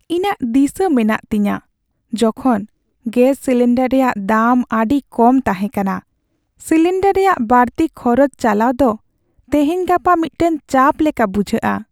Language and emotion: Santali, sad